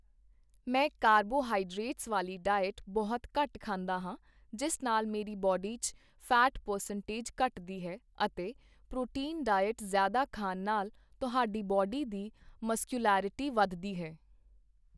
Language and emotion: Punjabi, neutral